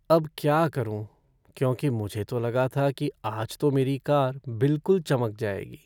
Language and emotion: Hindi, sad